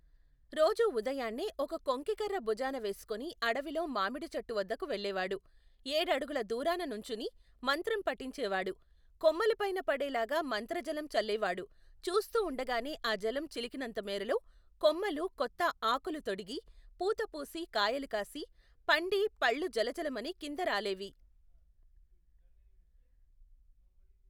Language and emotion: Telugu, neutral